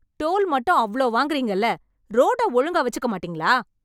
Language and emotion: Tamil, angry